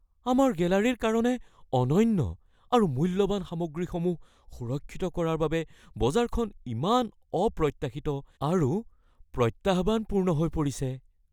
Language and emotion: Assamese, fearful